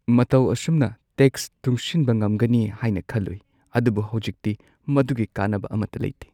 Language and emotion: Manipuri, sad